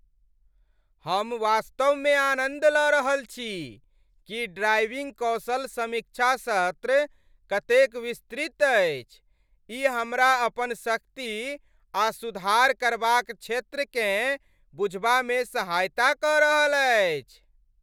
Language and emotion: Maithili, happy